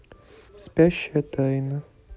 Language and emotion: Russian, neutral